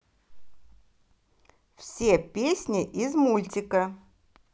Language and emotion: Russian, positive